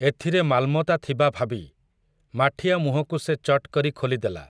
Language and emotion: Odia, neutral